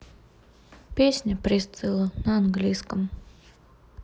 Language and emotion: Russian, neutral